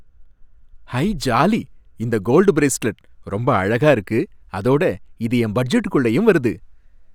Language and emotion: Tamil, happy